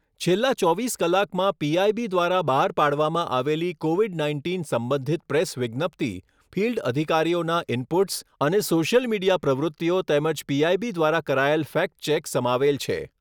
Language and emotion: Gujarati, neutral